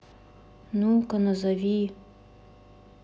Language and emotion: Russian, neutral